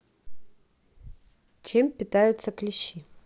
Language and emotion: Russian, neutral